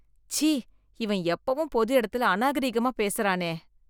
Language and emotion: Tamil, disgusted